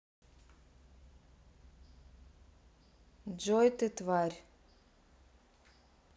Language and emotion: Russian, neutral